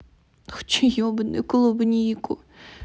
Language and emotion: Russian, angry